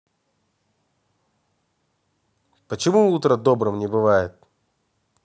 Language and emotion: Russian, angry